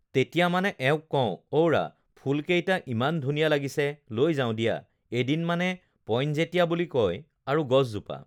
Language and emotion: Assamese, neutral